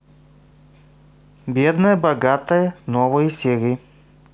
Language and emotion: Russian, neutral